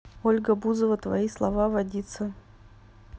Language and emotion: Russian, neutral